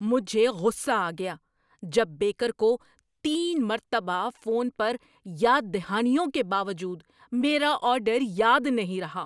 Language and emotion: Urdu, angry